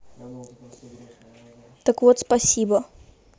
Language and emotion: Russian, neutral